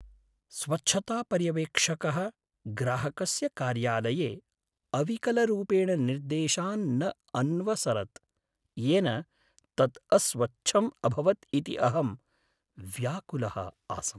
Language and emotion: Sanskrit, sad